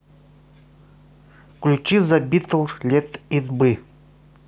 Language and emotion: Russian, neutral